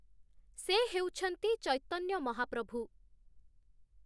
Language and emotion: Odia, neutral